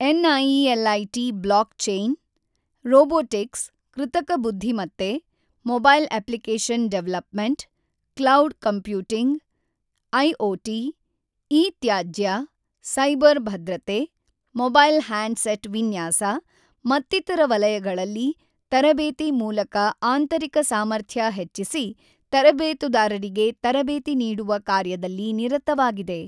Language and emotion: Kannada, neutral